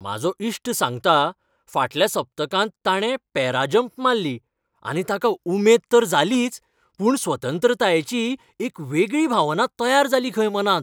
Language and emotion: Goan Konkani, happy